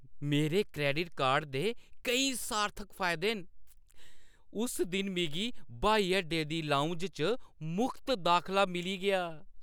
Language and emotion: Dogri, happy